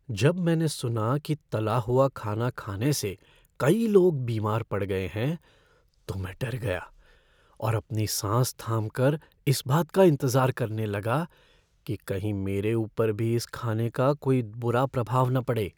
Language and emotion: Hindi, fearful